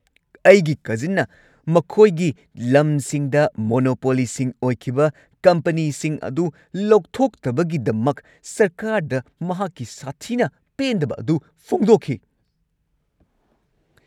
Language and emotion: Manipuri, angry